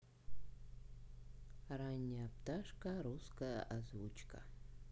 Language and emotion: Russian, neutral